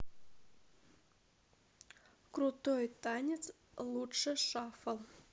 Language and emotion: Russian, neutral